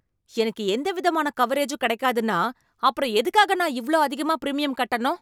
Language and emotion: Tamil, angry